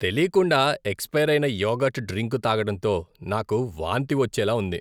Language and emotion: Telugu, disgusted